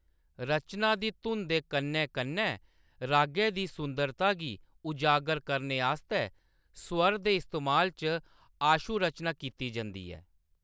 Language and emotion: Dogri, neutral